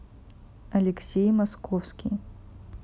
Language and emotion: Russian, neutral